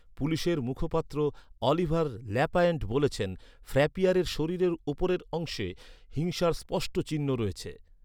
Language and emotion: Bengali, neutral